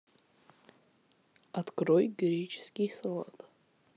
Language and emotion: Russian, neutral